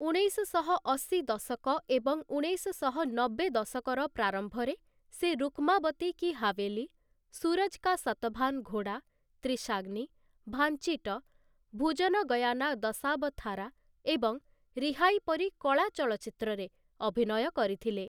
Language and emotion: Odia, neutral